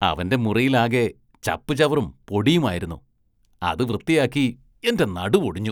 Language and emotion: Malayalam, disgusted